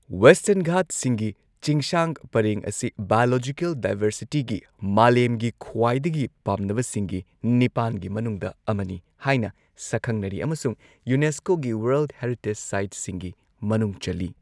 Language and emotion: Manipuri, neutral